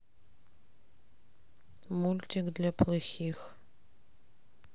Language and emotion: Russian, neutral